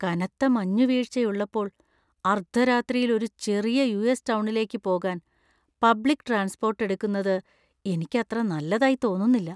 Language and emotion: Malayalam, fearful